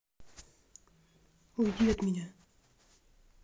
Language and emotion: Russian, angry